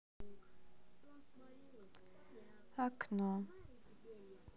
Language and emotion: Russian, sad